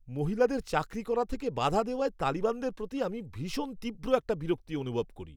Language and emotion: Bengali, angry